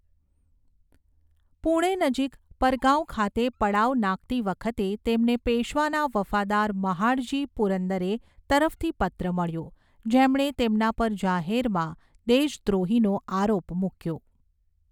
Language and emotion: Gujarati, neutral